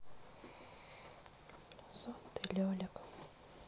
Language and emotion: Russian, sad